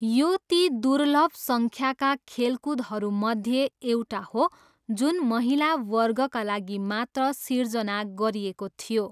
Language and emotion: Nepali, neutral